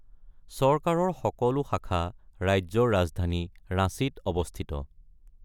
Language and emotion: Assamese, neutral